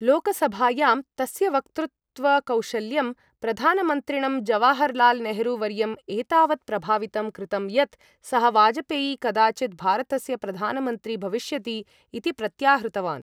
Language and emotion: Sanskrit, neutral